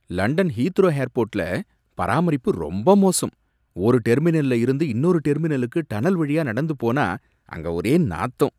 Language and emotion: Tamil, disgusted